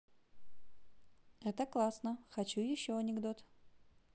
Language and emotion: Russian, positive